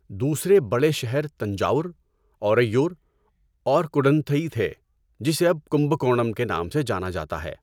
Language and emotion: Urdu, neutral